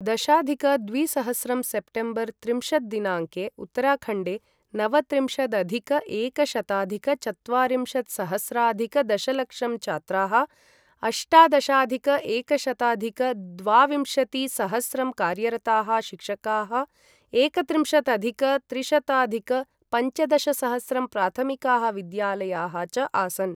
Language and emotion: Sanskrit, neutral